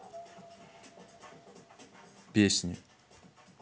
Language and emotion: Russian, neutral